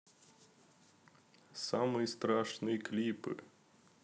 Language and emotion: Russian, neutral